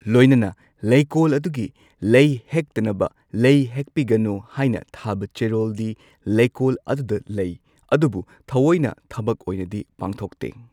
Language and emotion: Manipuri, neutral